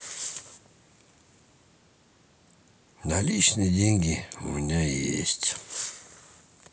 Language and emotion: Russian, sad